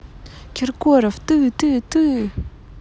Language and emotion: Russian, angry